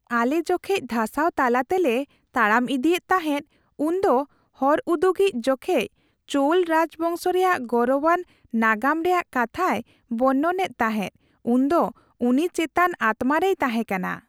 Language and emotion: Santali, happy